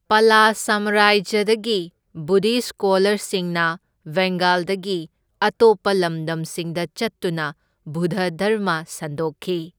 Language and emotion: Manipuri, neutral